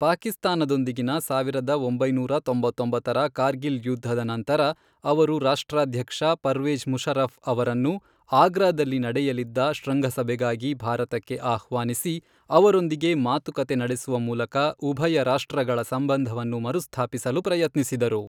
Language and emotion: Kannada, neutral